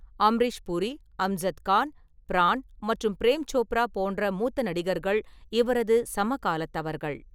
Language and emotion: Tamil, neutral